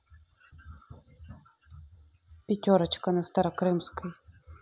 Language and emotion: Russian, neutral